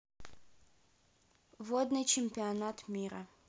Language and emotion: Russian, neutral